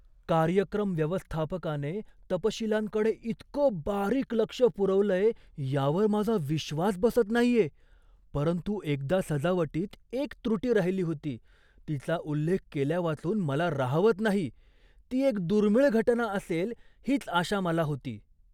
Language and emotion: Marathi, surprised